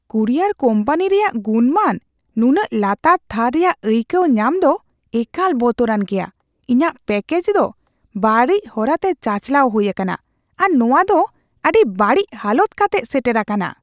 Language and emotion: Santali, disgusted